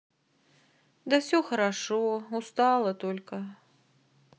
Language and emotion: Russian, sad